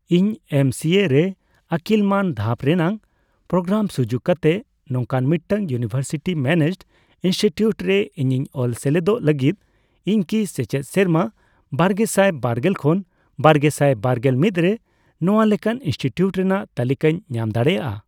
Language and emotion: Santali, neutral